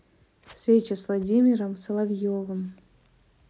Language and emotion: Russian, neutral